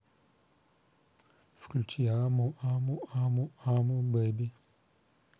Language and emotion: Russian, neutral